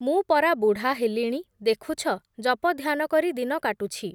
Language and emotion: Odia, neutral